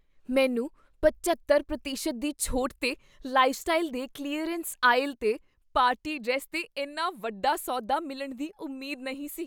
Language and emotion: Punjabi, surprised